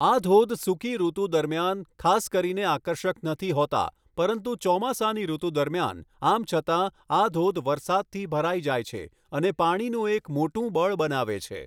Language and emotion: Gujarati, neutral